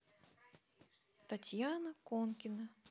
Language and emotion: Russian, neutral